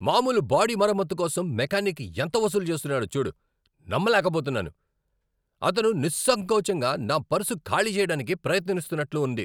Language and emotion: Telugu, angry